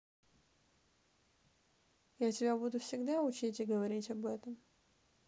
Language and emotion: Russian, neutral